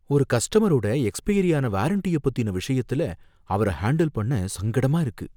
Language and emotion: Tamil, fearful